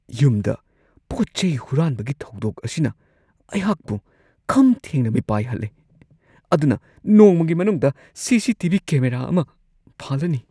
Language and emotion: Manipuri, fearful